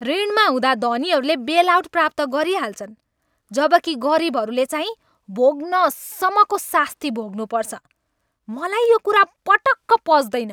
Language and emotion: Nepali, angry